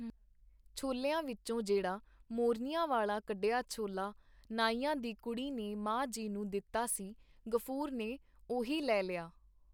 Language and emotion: Punjabi, neutral